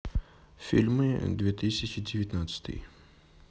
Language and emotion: Russian, neutral